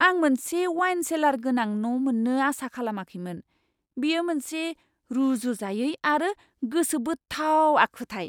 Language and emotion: Bodo, surprised